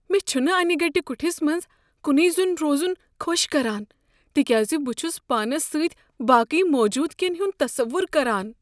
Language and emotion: Kashmiri, fearful